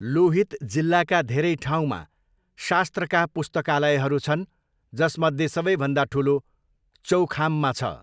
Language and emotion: Nepali, neutral